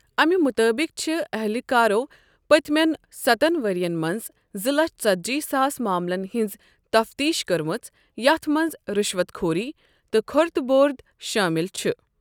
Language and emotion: Kashmiri, neutral